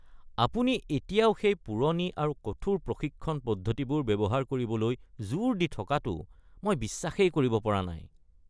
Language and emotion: Assamese, disgusted